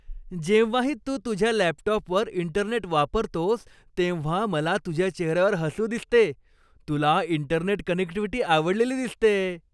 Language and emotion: Marathi, happy